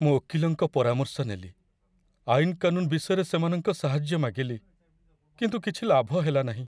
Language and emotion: Odia, sad